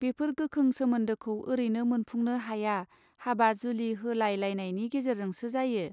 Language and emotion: Bodo, neutral